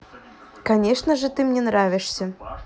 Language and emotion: Russian, positive